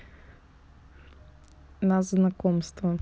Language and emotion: Russian, neutral